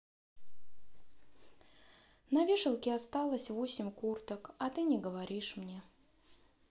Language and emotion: Russian, sad